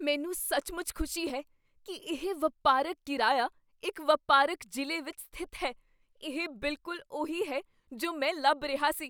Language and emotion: Punjabi, surprised